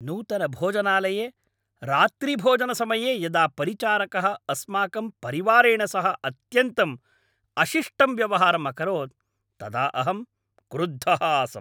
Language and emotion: Sanskrit, angry